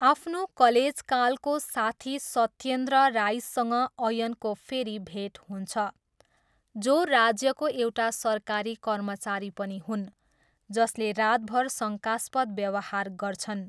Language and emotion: Nepali, neutral